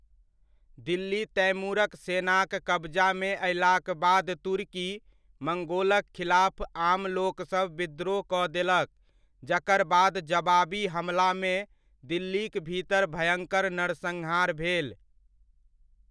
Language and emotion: Maithili, neutral